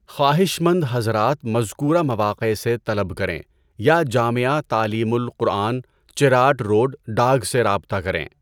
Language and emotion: Urdu, neutral